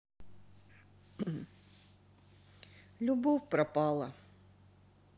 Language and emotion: Russian, sad